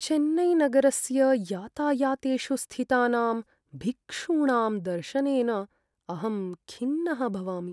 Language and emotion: Sanskrit, sad